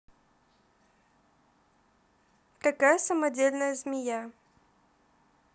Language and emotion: Russian, neutral